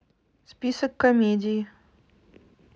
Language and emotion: Russian, neutral